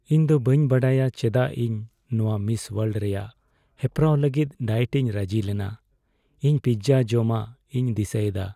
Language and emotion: Santali, sad